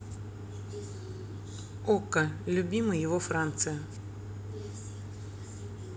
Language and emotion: Russian, neutral